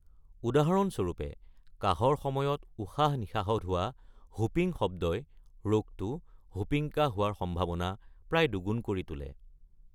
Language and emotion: Assamese, neutral